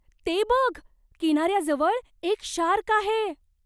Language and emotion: Marathi, surprised